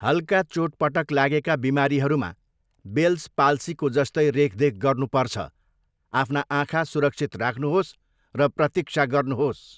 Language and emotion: Nepali, neutral